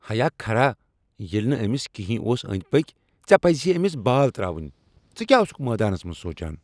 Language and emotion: Kashmiri, angry